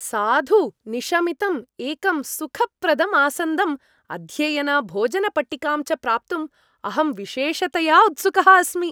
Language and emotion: Sanskrit, happy